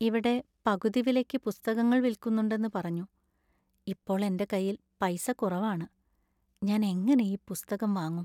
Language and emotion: Malayalam, sad